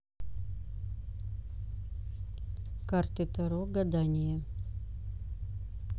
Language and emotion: Russian, neutral